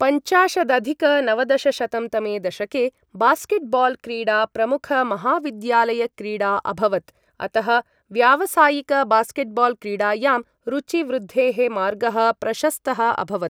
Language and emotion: Sanskrit, neutral